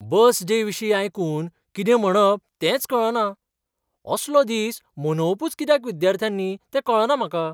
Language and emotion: Goan Konkani, surprised